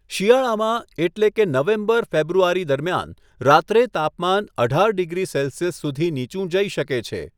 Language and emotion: Gujarati, neutral